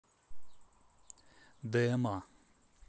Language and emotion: Russian, neutral